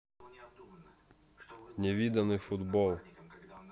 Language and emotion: Russian, neutral